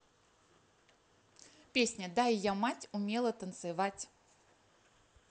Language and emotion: Russian, positive